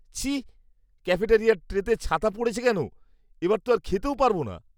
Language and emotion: Bengali, disgusted